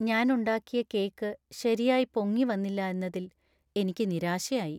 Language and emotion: Malayalam, sad